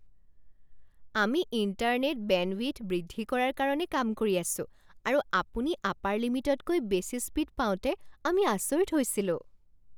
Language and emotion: Assamese, surprised